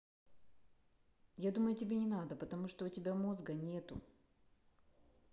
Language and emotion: Russian, neutral